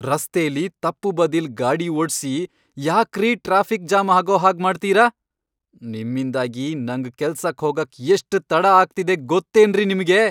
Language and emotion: Kannada, angry